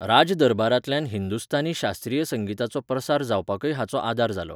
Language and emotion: Goan Konkani, neutral